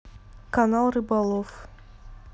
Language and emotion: Russian, neutral